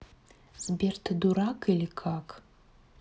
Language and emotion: Russian, neutral